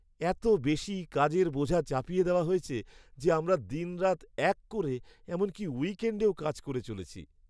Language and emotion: Bengali, sad